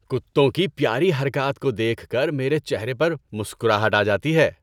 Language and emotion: Urdu, happy